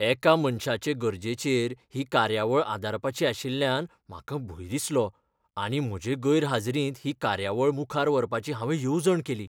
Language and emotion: Goan Konkani, fearful